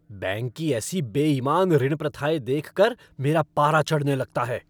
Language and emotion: Hindi, angry